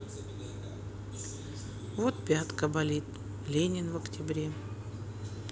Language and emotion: Russian, sad